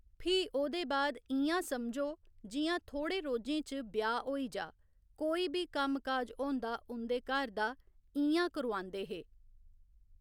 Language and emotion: Dogri, neutral